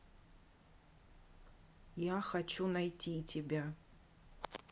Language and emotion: Russian, neutral